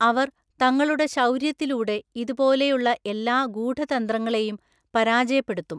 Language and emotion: Malayalam, neutral